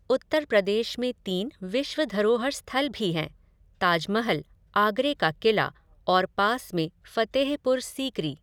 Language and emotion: Hindi, neutral